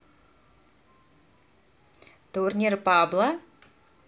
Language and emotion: Russian, neutral